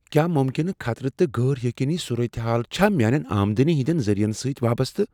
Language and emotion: Kashmiri, fearful